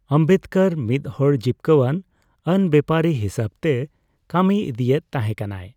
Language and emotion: Santali, neutral